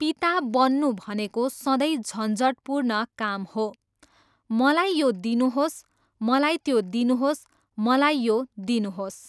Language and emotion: Nepali, neutral